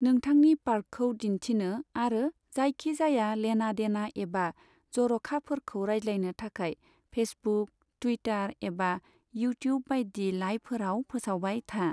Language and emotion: Bodo, neutral